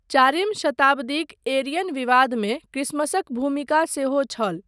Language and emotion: Maithili, neutral